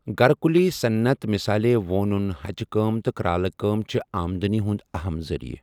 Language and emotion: Kashmiri, neutral